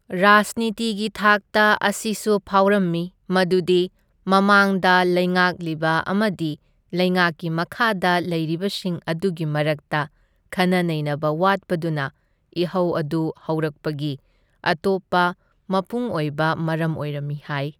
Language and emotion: Manipuri, neutral